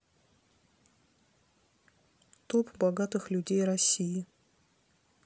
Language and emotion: Russian, neutral